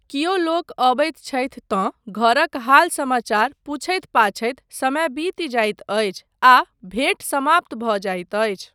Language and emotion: Maithili, neutral